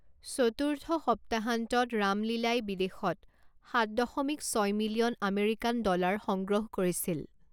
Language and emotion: Assamese, neutral